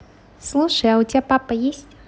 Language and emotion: Russian, neutral